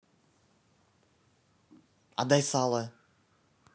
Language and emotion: Russian, neutral